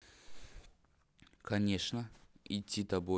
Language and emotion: Russian, neutral